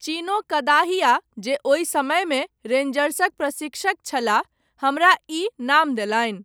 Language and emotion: Maithili, neutral